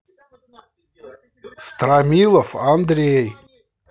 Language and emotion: Russian, angry